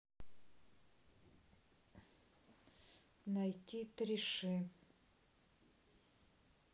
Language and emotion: Russian, neutral